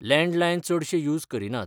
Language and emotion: Goan Konkani, neutral